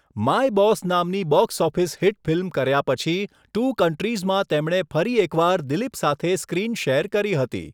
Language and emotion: Gujarati, neutral